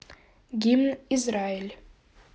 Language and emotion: Russian, neutral